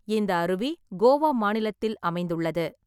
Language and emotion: Tamil, neutral